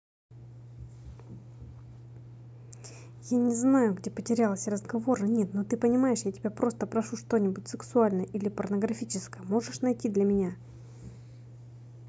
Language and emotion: Russian, angry